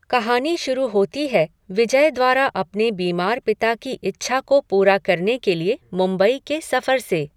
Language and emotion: Hindi, neutral